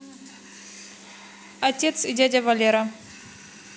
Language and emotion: Russian, neutral